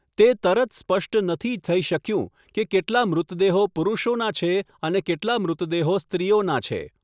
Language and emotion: Gujarati, neutral